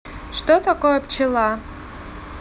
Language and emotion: Russian, neutral